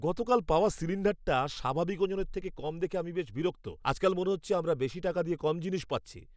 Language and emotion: Bengali, angry